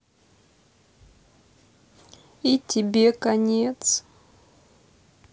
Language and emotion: Russian, sad